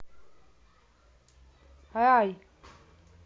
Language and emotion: Russian, neutral